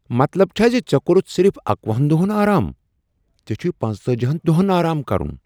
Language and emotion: Kashmiri, surprised